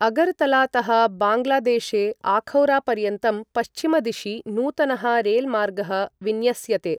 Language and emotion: Sanskrit, neutral